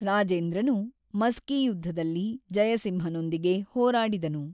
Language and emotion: Kannada, neutral